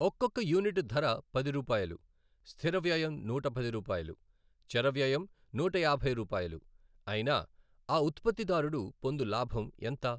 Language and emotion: Telugu, neutral